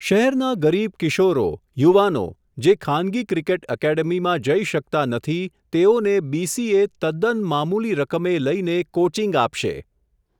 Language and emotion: Gujarati, neutral